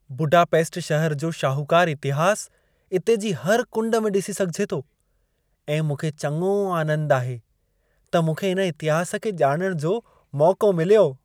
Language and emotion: Sindhi, happy